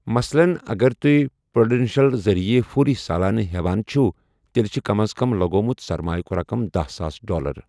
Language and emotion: Kashmiri, neutral